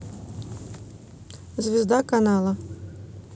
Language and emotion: Russian, neutral